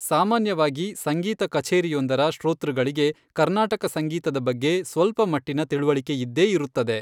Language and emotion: Kannada, neutral